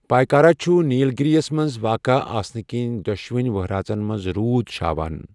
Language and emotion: Kashmiri, neutral